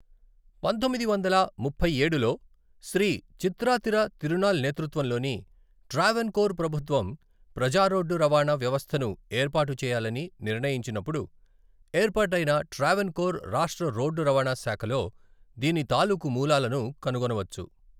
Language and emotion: Telugu, neutral